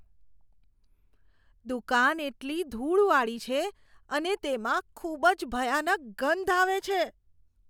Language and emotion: Gujarati, disgusted